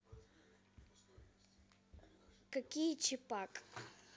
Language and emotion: Russian, neutral